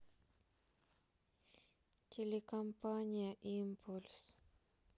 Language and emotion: Russian, sad